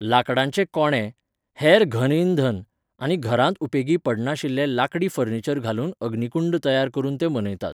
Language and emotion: Goan Konkani, neutral